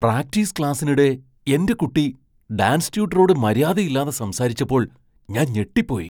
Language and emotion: Malayalam, surprised